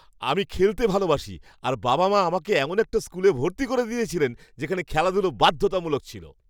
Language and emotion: Bengali, happy